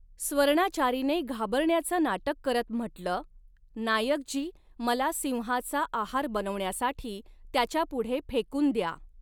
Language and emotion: Marathi, neutral